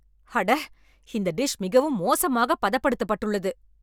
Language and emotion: Tamil, angry